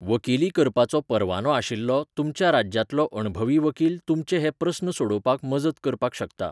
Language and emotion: Goan Konkani, neutral